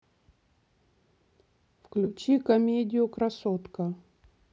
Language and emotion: Russian, neutral